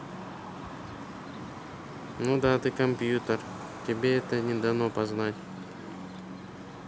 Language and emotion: Russian, neutral